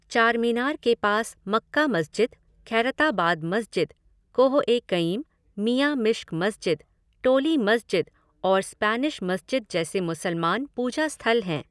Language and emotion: Hindi, neutral